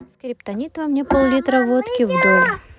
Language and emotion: Russian, neutral